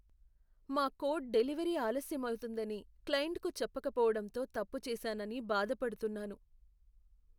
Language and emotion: Telugu, sad